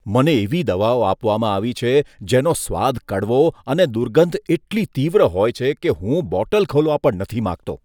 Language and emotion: Gujarati, disgusted